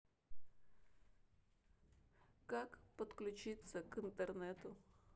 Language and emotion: Russian, sad